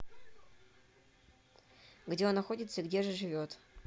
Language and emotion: Russian, neutral